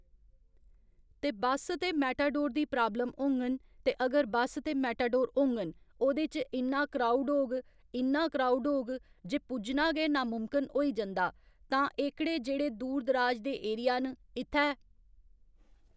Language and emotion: Dogri, neutral